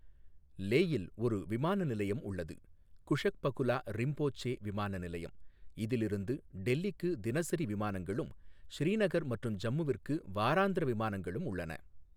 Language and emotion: Tamil, neutral